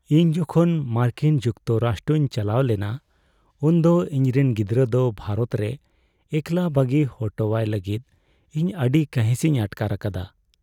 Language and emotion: Santali, sad